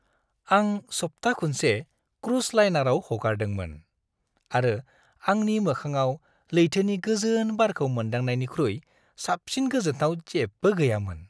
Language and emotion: Bodo, happy